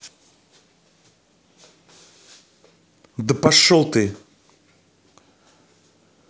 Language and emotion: Russian, angry